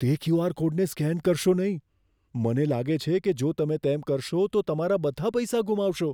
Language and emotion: Gujarati, fearful